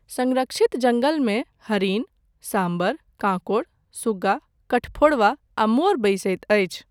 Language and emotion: Maithili, neutral